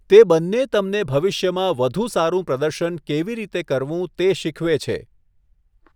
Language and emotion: Gujarati, neutral